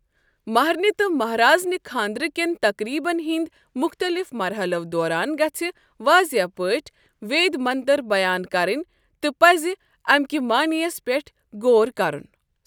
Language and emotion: Kashmiri, neutral